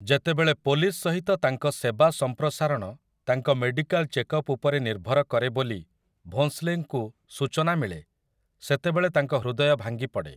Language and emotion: Odia, neutral